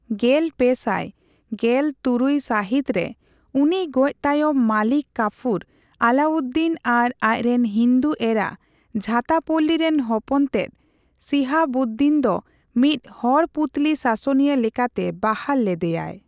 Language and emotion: Santali, neutral